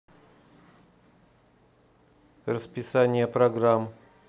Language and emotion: Russian, neutral